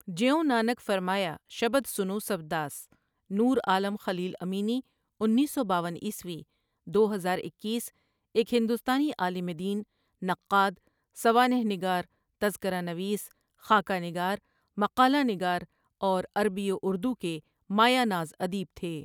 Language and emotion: Urdu, neutral